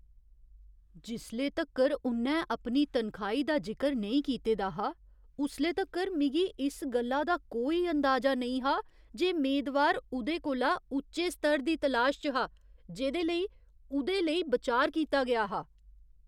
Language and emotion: Dogri, surprised